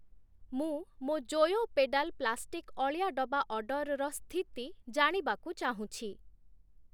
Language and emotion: Odia, neutral